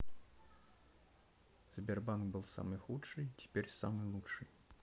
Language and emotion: Russian, neutral